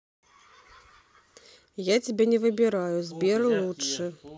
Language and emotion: Russian, neutral